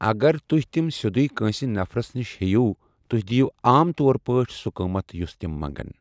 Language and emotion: Kashmiri, neutral